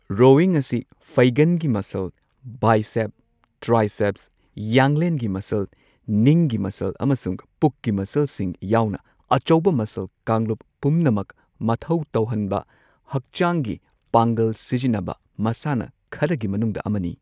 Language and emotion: Manipuri, neutral